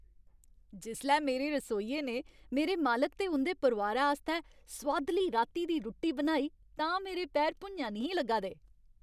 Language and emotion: Dogri, happy